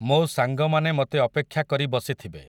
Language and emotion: Odia, neutral